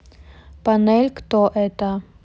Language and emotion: Russian, neutral